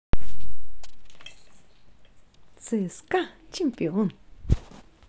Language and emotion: Russian, positive